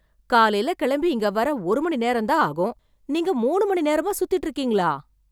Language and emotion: Tamil, surprised